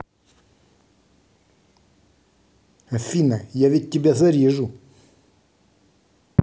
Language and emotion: Russian, angry